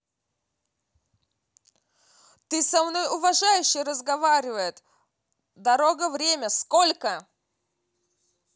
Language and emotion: Russian, angry